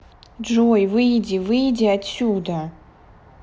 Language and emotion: Russian, angry